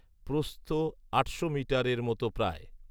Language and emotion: Bengali, neutral